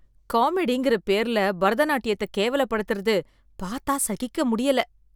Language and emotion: Tamil, disgusted